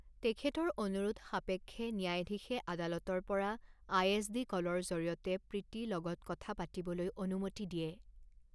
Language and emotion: Assamese, neutral